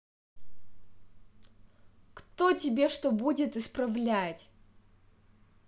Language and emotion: Russian, angry